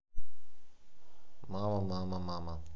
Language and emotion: Russian, neutral